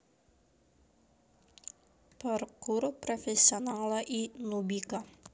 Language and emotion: Russian, neutral